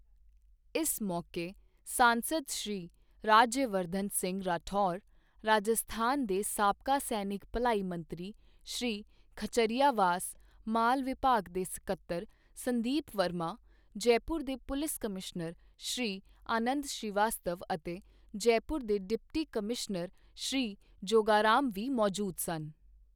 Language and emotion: Punjabi, neutral